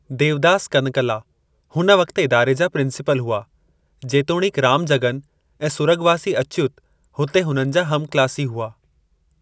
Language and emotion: Sindhi, neutral